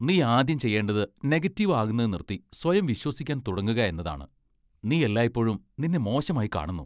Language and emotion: Malayalam, disgusted